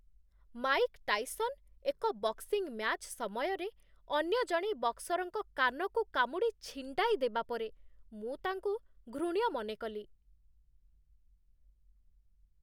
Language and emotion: Odia, disgusted